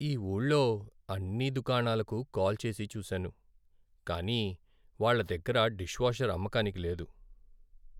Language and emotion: Telugu, sad